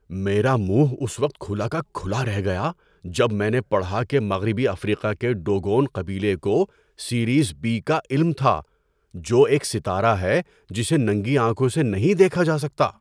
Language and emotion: Urdu, surprised